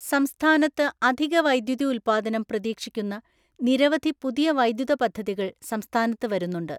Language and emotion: Malayalam, neutral